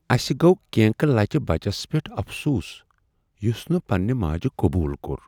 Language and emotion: Kashmiri, sad